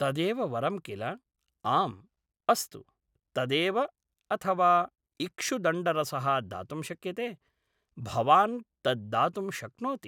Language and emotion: Sanskrit, neutral